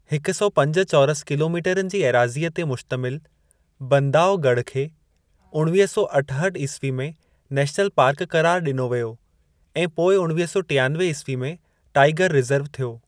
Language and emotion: Sindhi, neutral